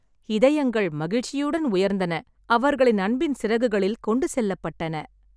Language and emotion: Tamil, happy